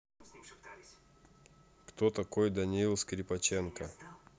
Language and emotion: Russian, neutral